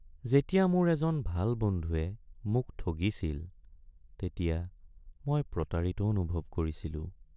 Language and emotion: Assamese, sad